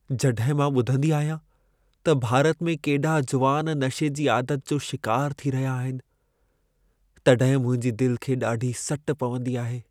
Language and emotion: Sindhi, sad